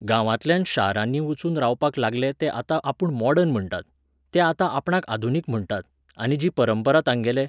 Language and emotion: Goan Konkani, neutral